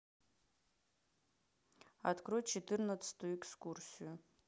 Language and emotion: Russian, neutral